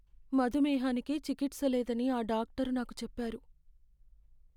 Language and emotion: Telugu, sad